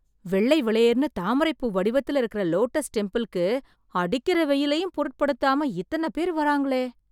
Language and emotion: Tamil, surprised